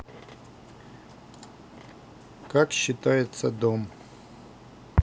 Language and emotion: Russian, neutral